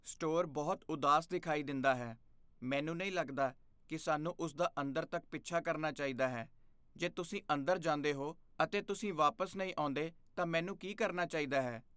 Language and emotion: Punjabi, fearful